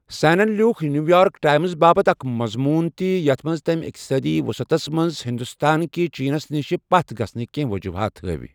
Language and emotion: Kashmiri, neutral